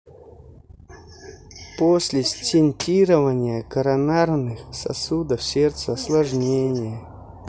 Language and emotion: Russian, neutral